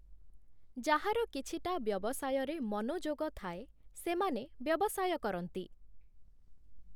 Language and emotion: Odia, neutral